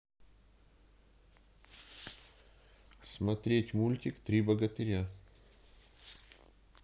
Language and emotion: Russian, neutral